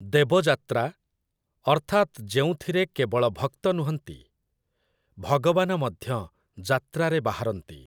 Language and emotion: Odia, neutral